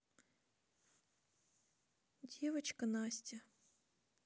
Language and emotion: Russian, sad